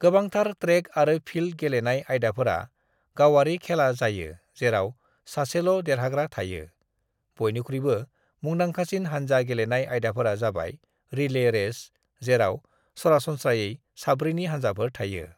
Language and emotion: Bodo, neutral